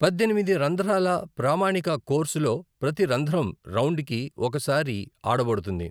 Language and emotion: Telugu, neutral